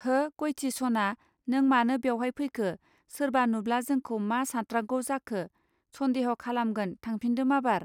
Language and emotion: Bodo, neutral